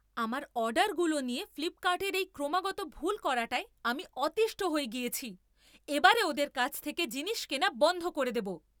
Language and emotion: Bengali, angry